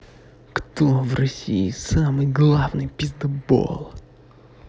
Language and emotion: Russian, angry